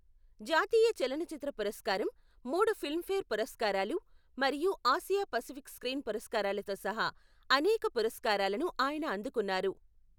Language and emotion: Telugu, neutral